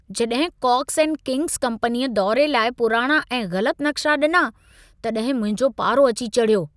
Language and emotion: Sindhi, angry